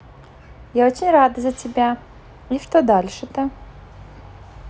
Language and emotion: Russian, positive